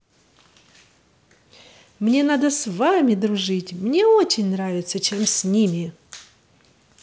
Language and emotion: Russian, positive